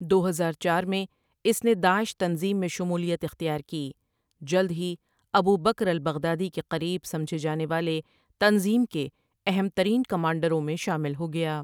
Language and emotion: Urdu, neutral